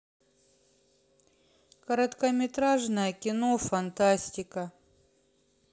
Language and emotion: Russian, sad